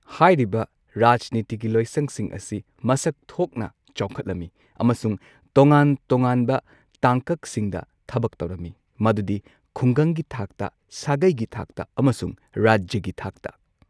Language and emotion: Manipuri, neutral